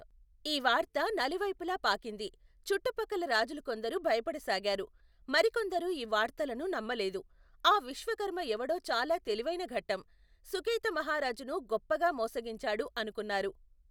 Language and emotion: Telugu, neutral